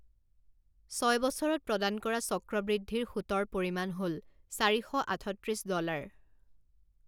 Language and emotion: Assamese, neutral